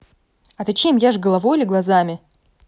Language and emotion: Russian, angry